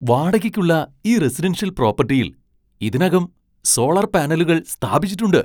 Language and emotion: Malayalam, surprised